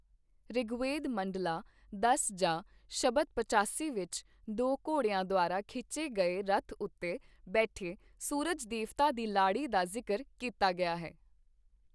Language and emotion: Punjabi, neutral